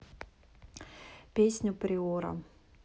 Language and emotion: Russian, neutral